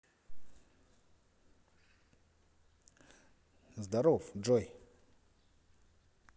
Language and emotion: Russian, positive